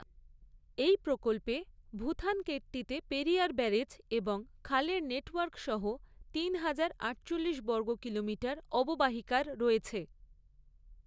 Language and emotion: Bengali, neutral